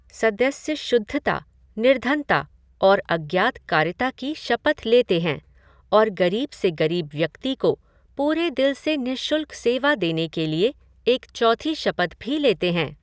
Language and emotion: Hindi, neutral